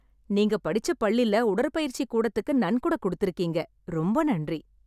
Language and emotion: Tamil, happy